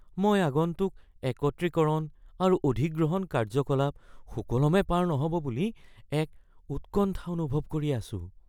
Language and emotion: Assamese, fearful